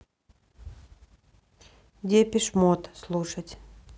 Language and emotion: Russian, neutral